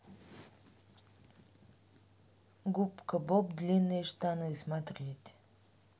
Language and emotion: Russian, neutral